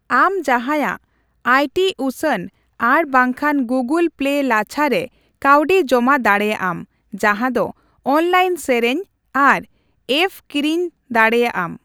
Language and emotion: Santali, neutral